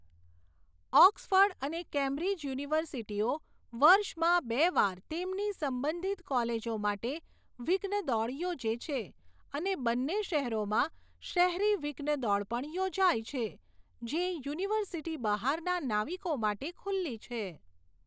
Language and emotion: Gujarati, neutral